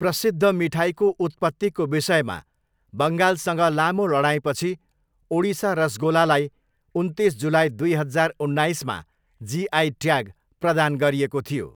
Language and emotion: Nepali, neutral